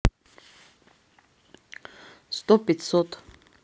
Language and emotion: Russian, neutral